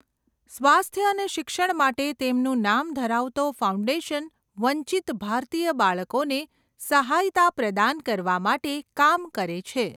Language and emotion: Gujarati, neutral